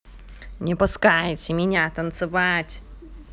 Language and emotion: Russian, angry